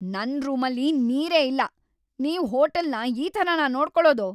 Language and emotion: Kannada, angry